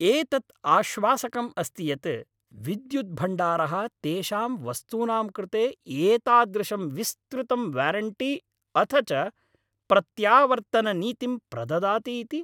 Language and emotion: Sanskrit, happy